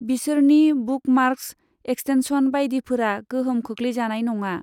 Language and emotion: Bodo, neutral